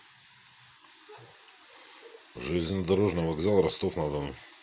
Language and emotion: Russian, neutral